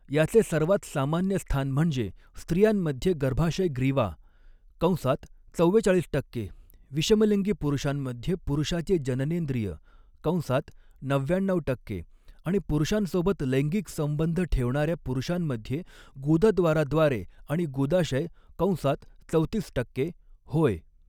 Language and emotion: Marathi, neutral